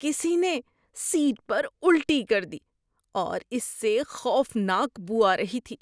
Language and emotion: Urdu, disgusted